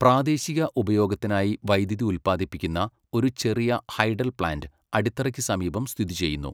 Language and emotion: Malayalam, neutral